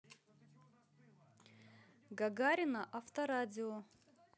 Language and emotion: Russian, positive